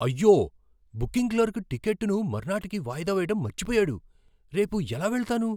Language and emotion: Telugu, surprised